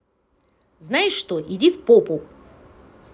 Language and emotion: Russian, angry